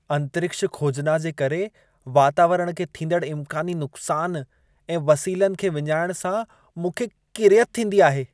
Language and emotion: Sindhi, disgusted